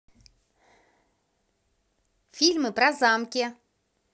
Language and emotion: Russian, positive